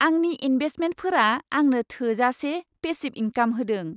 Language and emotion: Bodo, happy